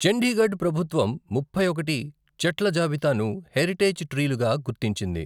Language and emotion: Telugu, neutral